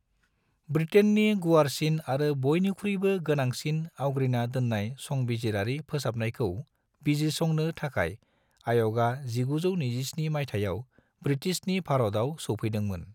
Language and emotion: Bodo, neutral